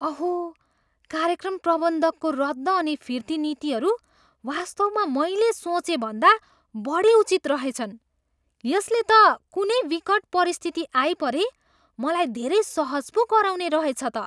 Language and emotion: Nepali, surprised